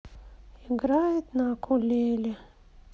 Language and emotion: Russian, sad